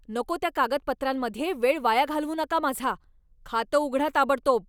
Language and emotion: Marathi, angry